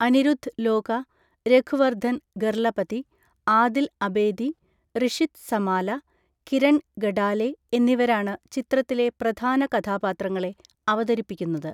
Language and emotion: Malayalam, neutral